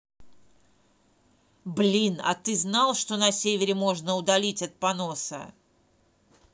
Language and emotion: Russian, angry